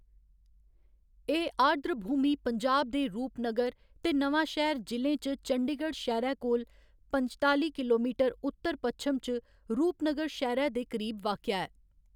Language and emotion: Dogri, neutral